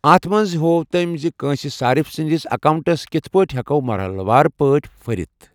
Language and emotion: Kashmiri, neutral